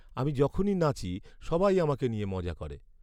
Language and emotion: Bengali, sad